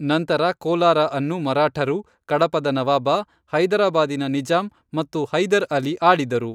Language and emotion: Kannada, neutral